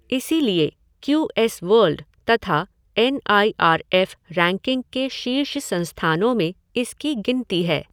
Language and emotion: Hindi, neutral